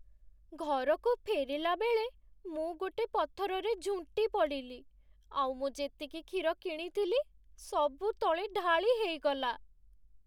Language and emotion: Odia, sad